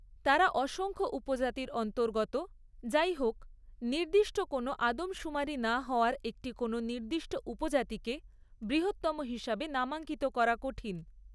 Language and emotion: Bengali, neutral